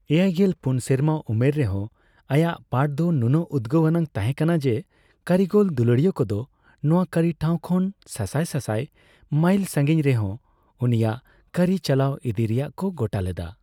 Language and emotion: Santali, neutral